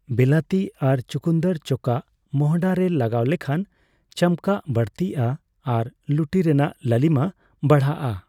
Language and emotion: Santali, neutral